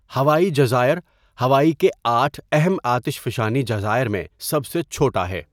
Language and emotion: Urdu, neutral